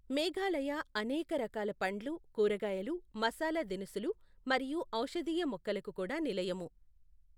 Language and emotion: Telugu, neutral